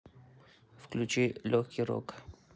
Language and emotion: Russian, neutral